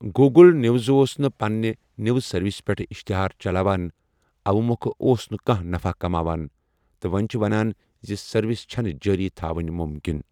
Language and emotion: Kashmiri, neutral